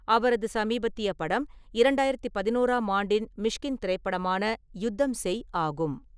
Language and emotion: Tamil, neutral